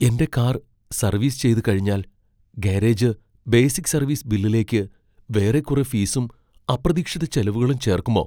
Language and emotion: Malayalam, fearful